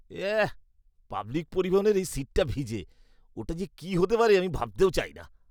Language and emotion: Bengali, disgusted